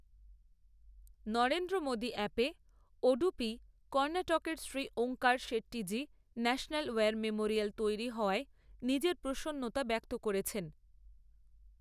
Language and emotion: Bengali, neutral